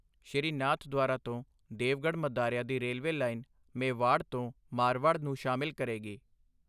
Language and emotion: Punjabi, neutral